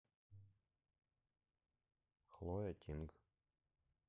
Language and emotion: Russian, neutral